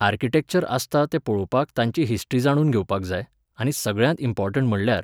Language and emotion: Goan Konkani, neutral